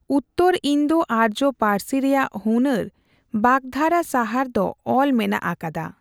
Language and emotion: Santali, neutral